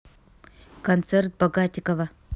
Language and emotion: Russian, neutral